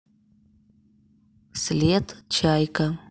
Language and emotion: Russian, neutral